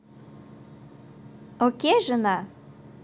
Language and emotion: Russian, positive